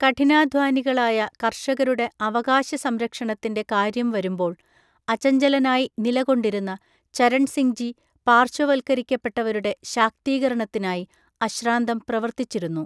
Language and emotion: Malayalam, neutral